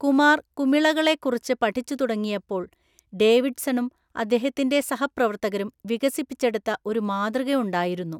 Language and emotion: Malayalam, neutral